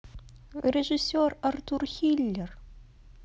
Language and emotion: Russian, sad